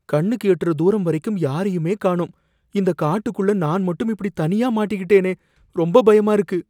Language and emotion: Tamil, fearful